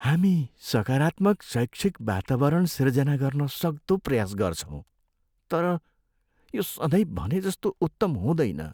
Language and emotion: Nepali, sad